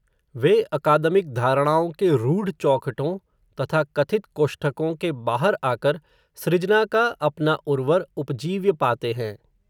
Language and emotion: Hindi, neutral